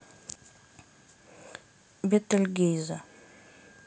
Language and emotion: Russian, neutral